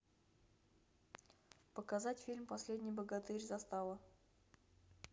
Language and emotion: Russian, neutral